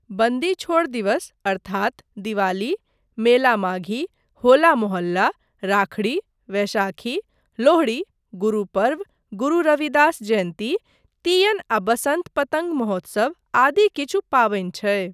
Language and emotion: Maithili, neutral